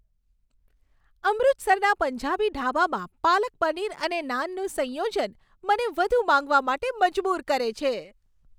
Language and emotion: Gujarati, happy